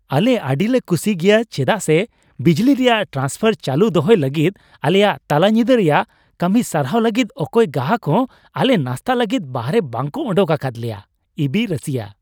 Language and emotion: Santali, happy